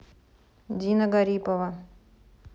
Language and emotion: Russian, neutral